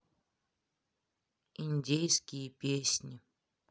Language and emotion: Russian, sad